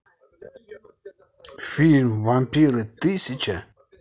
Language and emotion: Russian, neutral